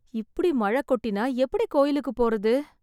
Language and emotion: Tamil, sad